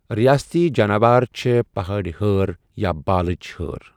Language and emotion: Kashmiri, neutral